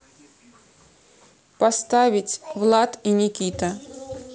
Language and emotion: Russian, neutral